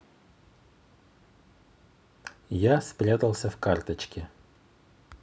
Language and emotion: Russian, neutral